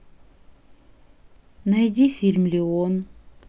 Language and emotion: Russian, neutral